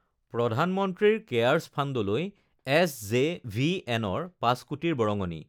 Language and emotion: Assamese, neutral